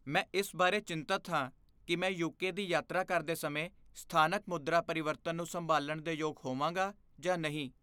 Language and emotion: Punjabi, fearful